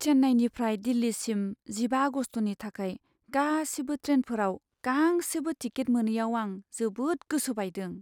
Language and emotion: Bodo, sad